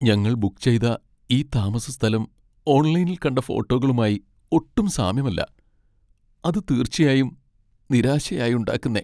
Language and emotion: Malayalam, sad